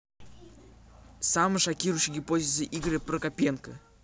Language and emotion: Russian, neutral